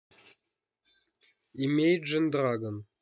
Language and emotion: Russian, neutral